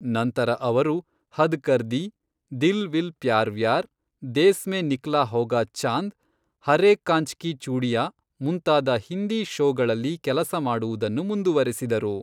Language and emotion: Kannada, neutral